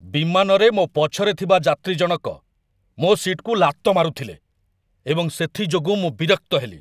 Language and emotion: Odia, angry